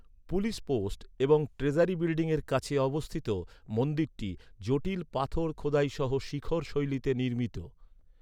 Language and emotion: Bengali, neutral